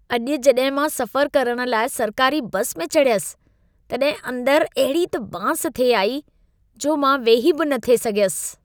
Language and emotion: Sindhi, disgusted